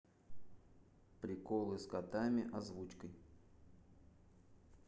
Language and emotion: Russian, neutral